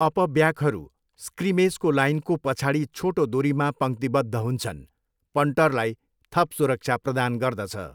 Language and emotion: Nepali, neutral